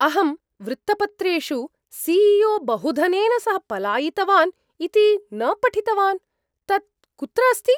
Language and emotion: Sanskrit, surprised